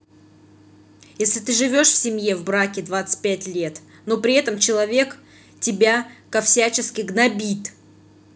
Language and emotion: Russian, angry